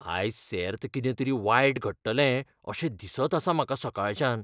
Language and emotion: Goan Konkani, fearful